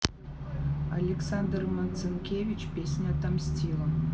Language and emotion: Russian, neutral